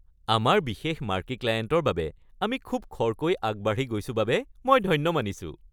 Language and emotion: Assamese, happy